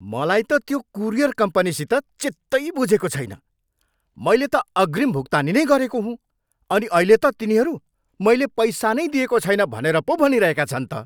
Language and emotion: Nepali, angry